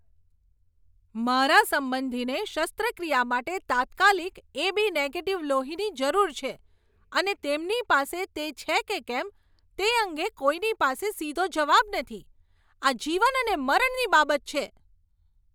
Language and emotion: Gujarati, angry